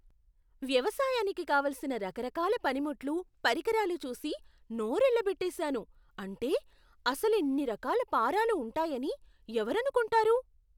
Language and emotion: Telugu, surprised